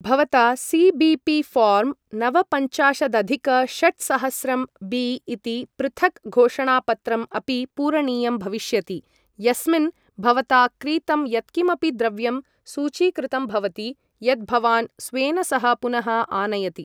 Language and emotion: Sanskrit, neutral